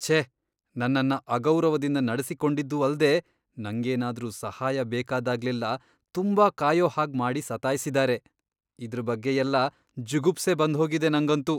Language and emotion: Kannada, disgusted